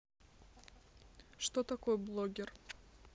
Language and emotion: Russian, neutral